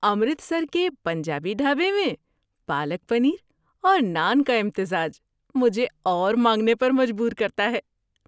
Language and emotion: Urdu, happy